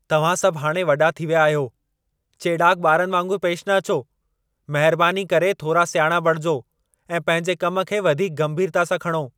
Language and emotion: Sindhi, angry